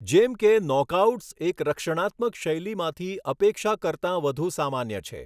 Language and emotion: Gujarati, neutral